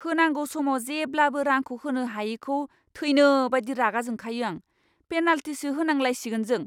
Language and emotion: Bodo, angry